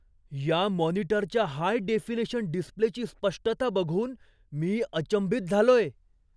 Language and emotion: Marathi, surprised